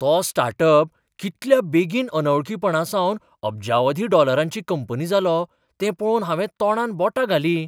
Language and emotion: Goan Konkani, surprised